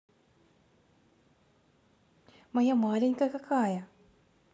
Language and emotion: Russian, positive